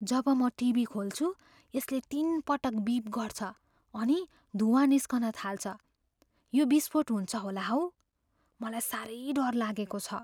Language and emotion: Nepali, fearful